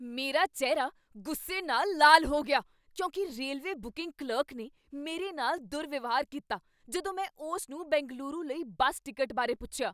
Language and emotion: Punjabi, angry